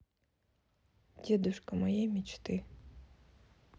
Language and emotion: Russian, neutral